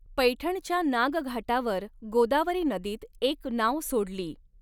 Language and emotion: Marathi, neutral